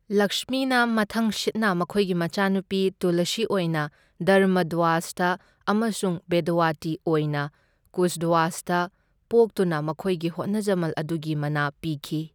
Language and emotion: Manipuri, neutral